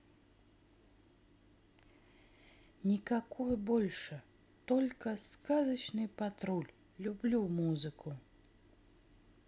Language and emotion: Russian, neutral